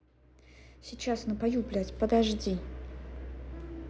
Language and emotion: Russian, angry